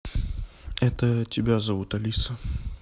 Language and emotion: Russian, neutral